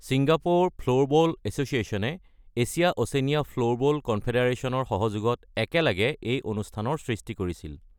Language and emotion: Assamese, neutral